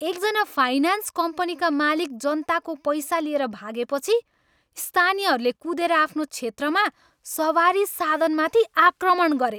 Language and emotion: Nepali, angry